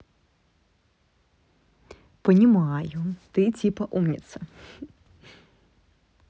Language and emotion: Russian, positive